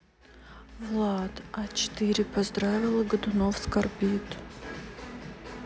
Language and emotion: Russian, sad